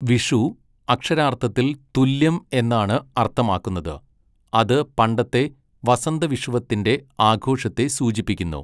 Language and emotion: Malayalam, neutral